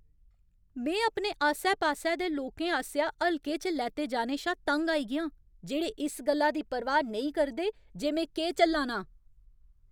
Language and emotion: Dogri, angry